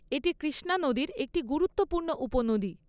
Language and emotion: Bengali, neutral